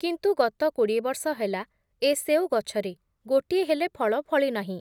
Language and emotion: Odia, neutral